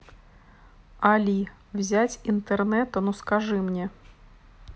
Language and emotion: Russian, neutral